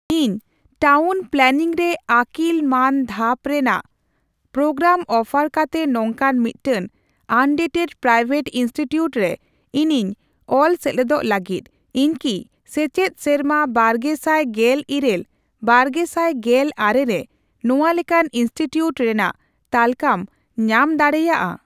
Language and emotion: Santali, neutral